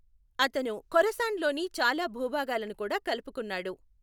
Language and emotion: Telugu, neutral